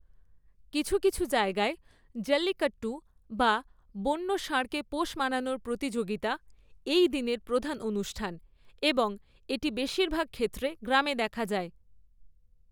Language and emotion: Bengali, neutral